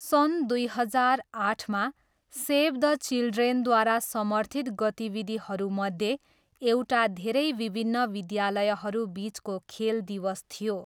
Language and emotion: Nepali, neutral